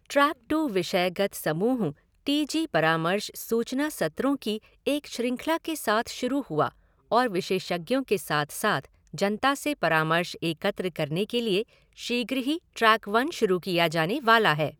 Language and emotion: Hindi, neutral